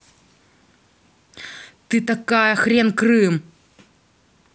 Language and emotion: Russian, angry